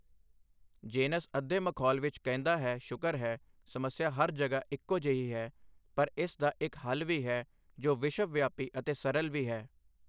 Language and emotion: Punjabi, neutral